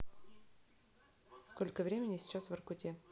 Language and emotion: Russian, neutral